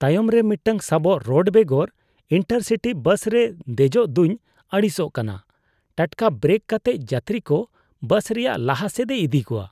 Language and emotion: Santali, disgusted